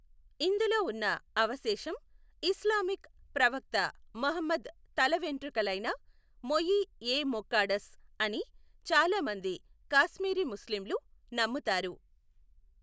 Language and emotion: Telugu, neutral